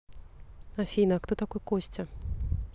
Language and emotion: Russian, neutral